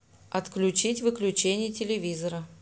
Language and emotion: Russian, neutral